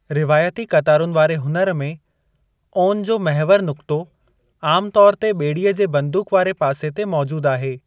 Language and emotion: Sindhi, neutral